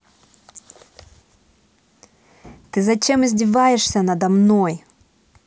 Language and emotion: Russian, angry